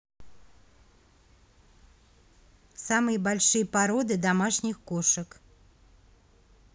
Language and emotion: Russian, neutral